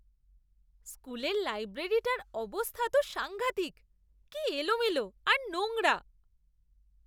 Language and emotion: Bengali, disgusted